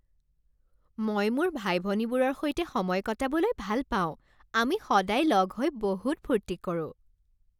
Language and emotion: Assamese, happy